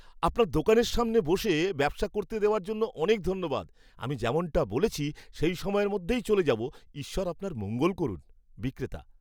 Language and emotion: Bengali, happy